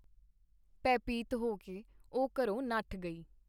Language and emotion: Punjabi, neutral